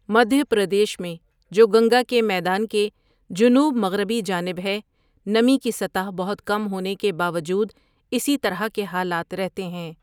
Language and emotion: Urdu, neutral